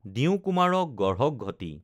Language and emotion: Assamese, neutral